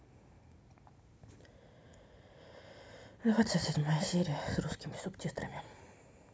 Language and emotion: Russian, sad